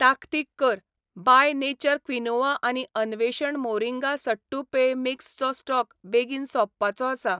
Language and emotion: Goan Konkani, neutral